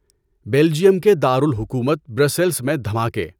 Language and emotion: Urdu, neutral